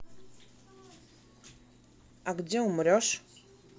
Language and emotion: Russian, neutral